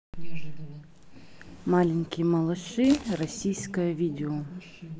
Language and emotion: Russian, neutral